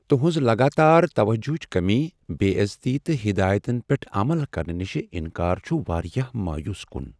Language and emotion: Kashmiri, sad